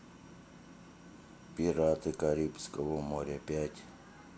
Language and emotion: Russian, neutral